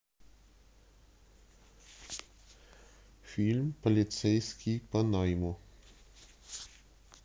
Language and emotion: Russian, neutral